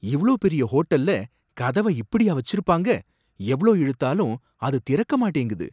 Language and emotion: Tamil, surprised